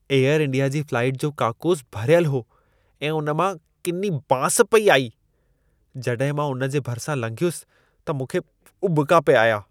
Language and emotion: Sindhi, disgusted